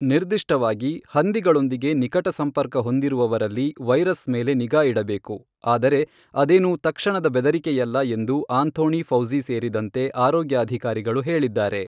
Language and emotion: Kannada, neutral